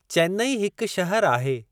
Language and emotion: Sindhi, neutral